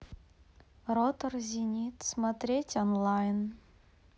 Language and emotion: Russian, neutral